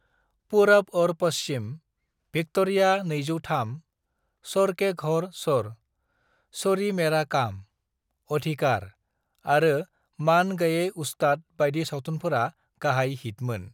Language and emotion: Bodo, neutral